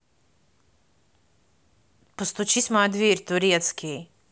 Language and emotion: Russian, neutral